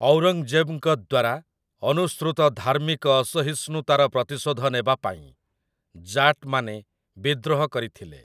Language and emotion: Odia, neutral